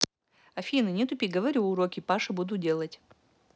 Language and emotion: Russian, neutral